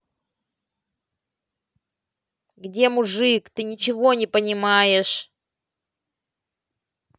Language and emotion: Russian, angry